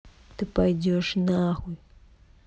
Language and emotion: Russian, angry